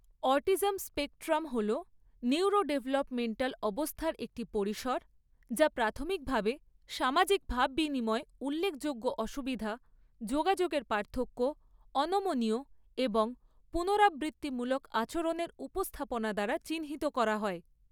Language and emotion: Bengali, neutral